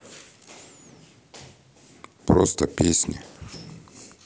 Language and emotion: Russian, neutral